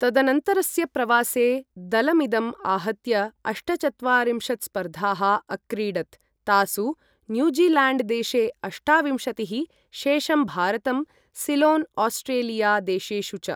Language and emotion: Sanskrit, neutral